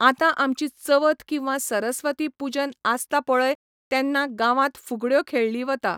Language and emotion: Goan Konkani, neutral